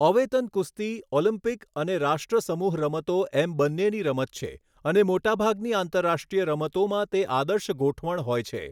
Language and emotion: Gujarati, neutral